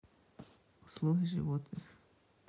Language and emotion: Russian, neutral